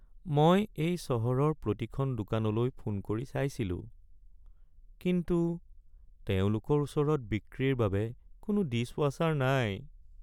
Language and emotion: Assamese, sad